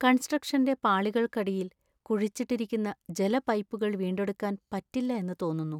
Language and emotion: Malayalam, sad